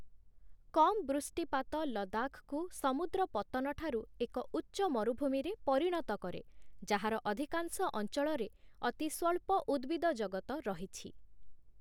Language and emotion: Odia, neutral